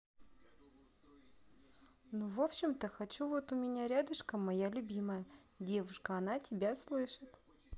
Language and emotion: Russian, neutral